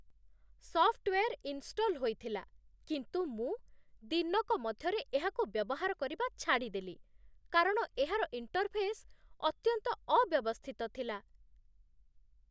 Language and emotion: Odia, disgusted